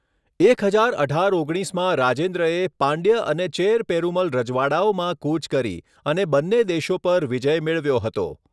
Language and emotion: Gujarati, neutral